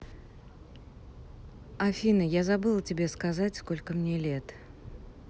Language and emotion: Russian, neutral